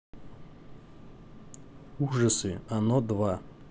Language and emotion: Russian, neutral